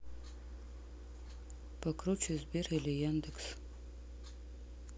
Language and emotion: Russian, neutral